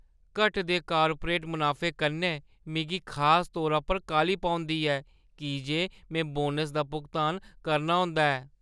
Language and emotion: Dogri, fearful